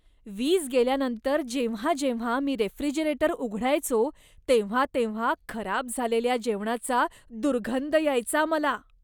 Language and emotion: Marathi, disgusted